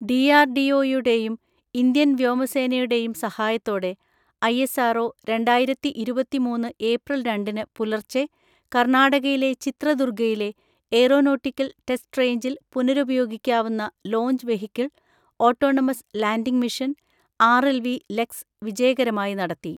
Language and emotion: Malayalam, neutral